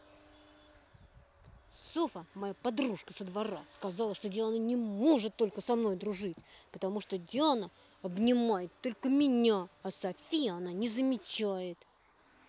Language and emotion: Russian, angry